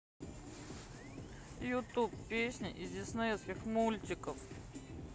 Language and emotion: Russian, sad